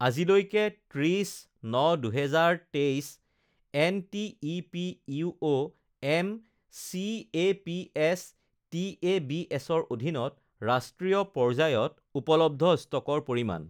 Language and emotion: Assamese, neutral